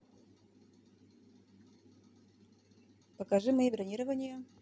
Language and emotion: Russian, neutral